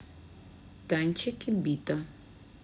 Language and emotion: Russian, neutral